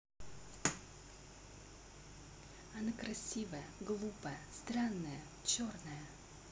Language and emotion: Russian, neutral